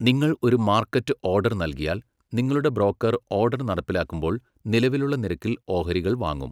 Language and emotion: Malayalam, neutral